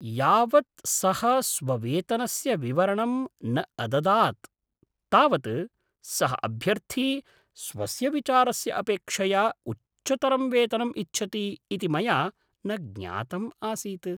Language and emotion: Sanskrit, surprised